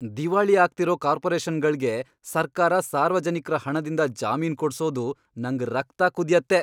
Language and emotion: Kannada, angry